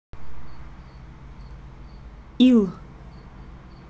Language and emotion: Russian, neutral